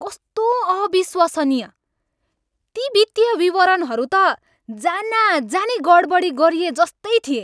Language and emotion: Nepali, angry